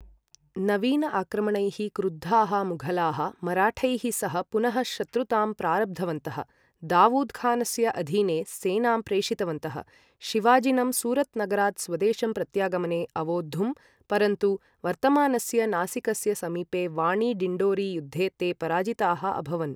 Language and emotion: Sanskrit, neutral